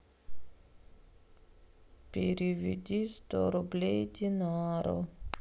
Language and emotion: Russian, sad